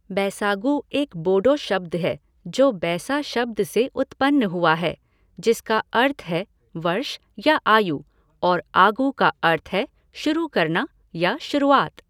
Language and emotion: Hindi, neutral